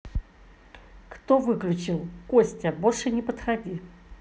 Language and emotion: Russian, angry